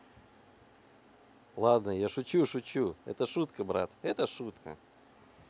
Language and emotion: Russian, positive